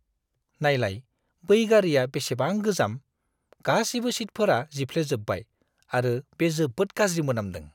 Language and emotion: Bodo, disgusted